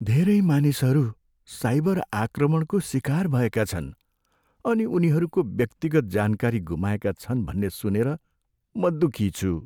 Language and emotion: Nepali, sad